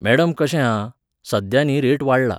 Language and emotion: Goan Konkani, neutral